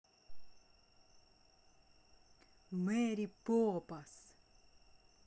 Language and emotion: Russian, angry